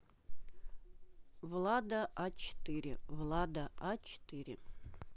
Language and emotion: Russian, neutral